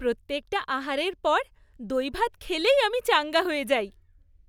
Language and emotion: Bengali, happy